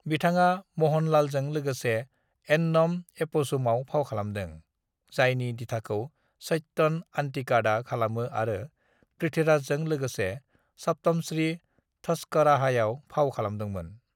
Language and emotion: Bodo, neutral